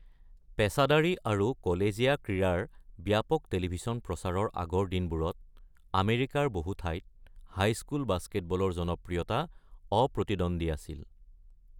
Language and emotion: Assamese, neutral